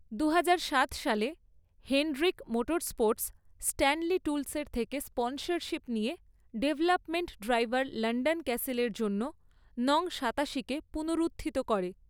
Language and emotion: Bengali, neutral